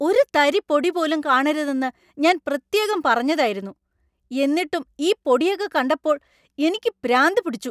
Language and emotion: Malayalam, angry